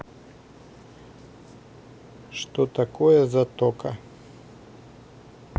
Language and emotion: Russian, neutral